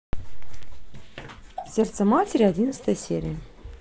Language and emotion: Russian, neutral